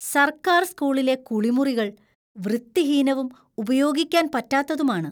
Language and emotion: Malayalam, disgusted